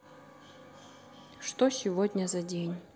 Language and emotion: Russian, neutral